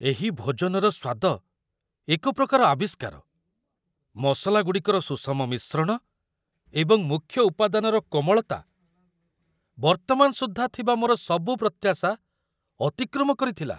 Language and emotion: Odia, surprised